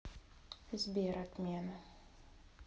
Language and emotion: Russian, sad